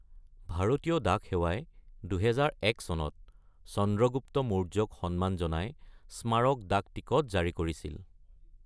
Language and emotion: Assamese, neutral